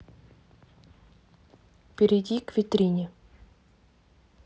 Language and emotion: Russian, neutral